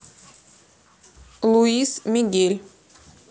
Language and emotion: Russian, neutral